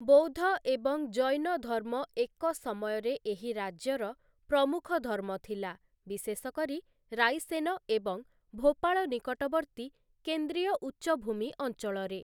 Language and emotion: Odia, neutral